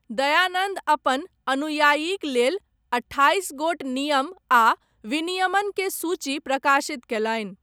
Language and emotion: Maithili, neutral